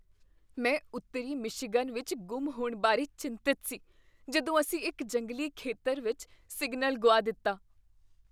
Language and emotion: Punjabi, fearful